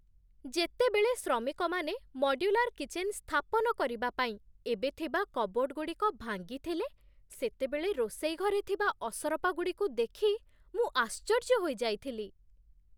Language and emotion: Odia, surprised